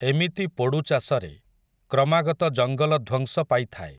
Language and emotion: Odia, neutral